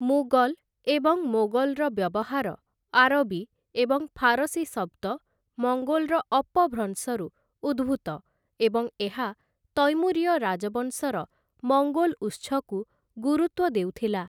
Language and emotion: Odia, neutral